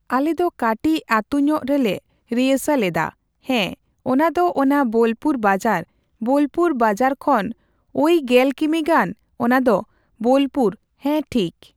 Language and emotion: Santali, neutral